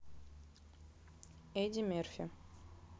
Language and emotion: Russian, neutral